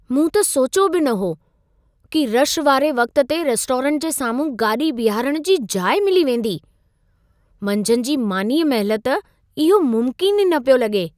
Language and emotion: Sindhi, surprised